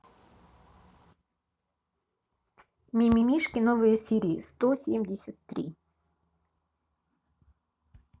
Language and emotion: Russian, neutral